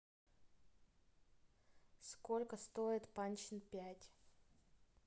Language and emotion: Russian, neutral